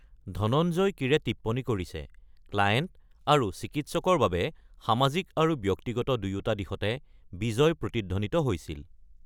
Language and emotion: Assamese, neutral